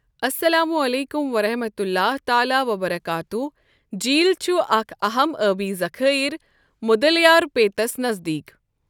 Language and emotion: Kashmiri, neutral